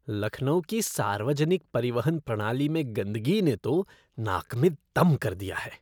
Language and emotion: Hindi, disgusted